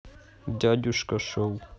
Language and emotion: Russian, neutral